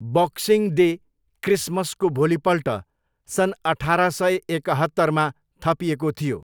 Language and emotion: Nepali, neutral